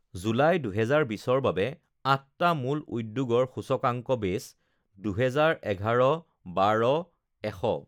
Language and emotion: Assamese, neutral